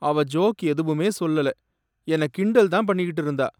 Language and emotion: Tamil, sad